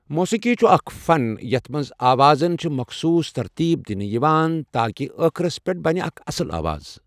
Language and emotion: Kashmiri, neutral